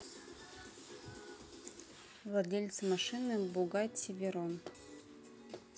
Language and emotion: Russian, neutral